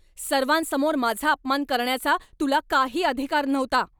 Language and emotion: Marathi, angry